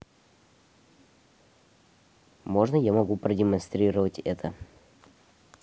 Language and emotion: Russian, neutral